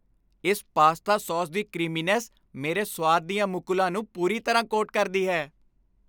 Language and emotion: Punjabi, happy